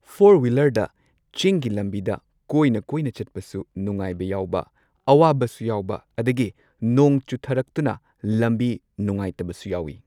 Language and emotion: Manipuri, neutral